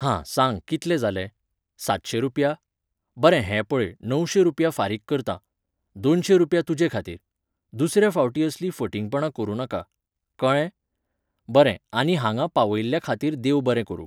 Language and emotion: Goan Konkani, neutral